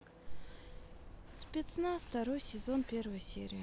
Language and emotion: Russian, neutral